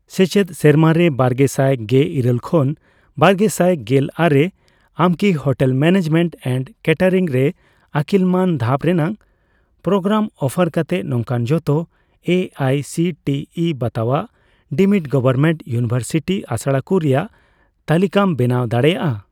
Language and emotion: Santali, neutral